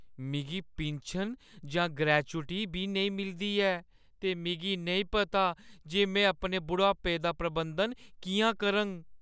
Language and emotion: Dogri, fearful